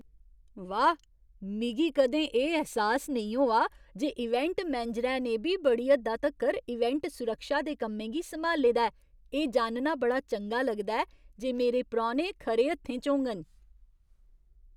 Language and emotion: Dogri, surprised